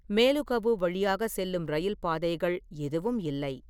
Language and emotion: Tamil, neutral